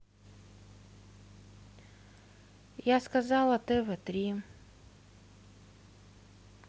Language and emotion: Russian, neutral